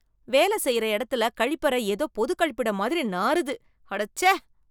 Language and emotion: Tamil, disgusted